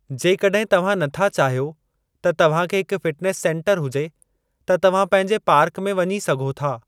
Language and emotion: Sindhi, neutral